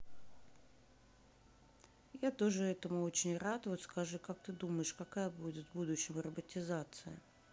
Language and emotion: Russian, neutral